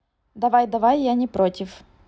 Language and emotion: Russian, neutral